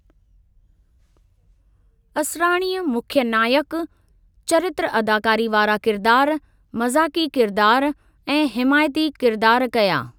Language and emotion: Sindhi, neutral